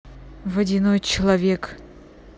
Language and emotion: Russian, neutral